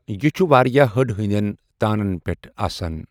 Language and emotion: Kashmiri, neutral